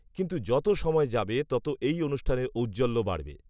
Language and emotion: Bengali, neutral